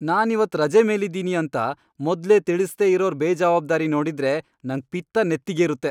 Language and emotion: Kannada, angry